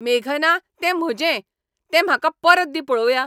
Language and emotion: Goan Konkani, angry